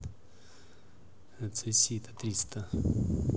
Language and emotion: Russian, neutral